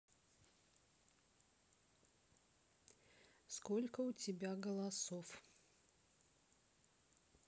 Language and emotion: Russian, neutral